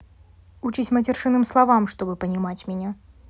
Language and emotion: Russian, neutral